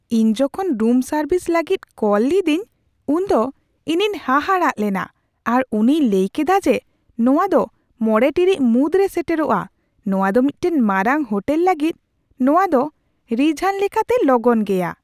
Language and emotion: Santali, surprised